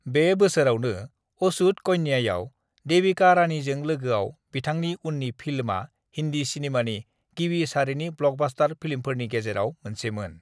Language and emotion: Bodo, neutral